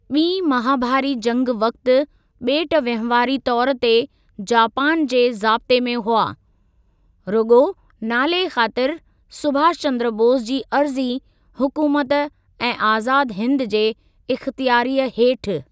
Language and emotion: Sindhi, neutral